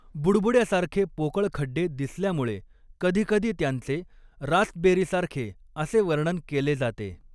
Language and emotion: Marathi, neutral